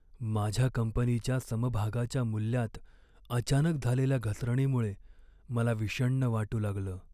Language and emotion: Marathi, sad